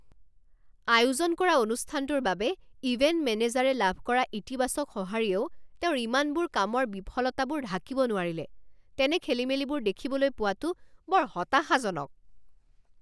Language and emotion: Assamese, angry